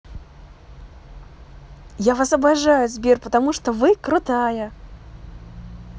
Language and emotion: Russian, positive